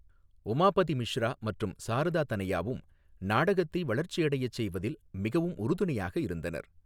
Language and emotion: Tamil, neutral